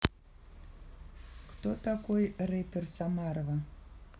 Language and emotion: Russian, neutral